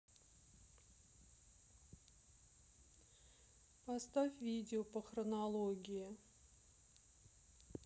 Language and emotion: Russian, sad